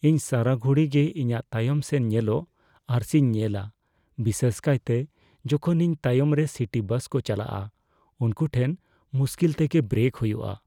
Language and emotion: Santali, fearful